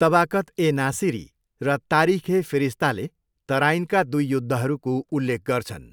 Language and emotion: Nepali, neutral